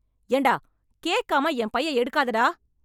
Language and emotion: Tamil, angry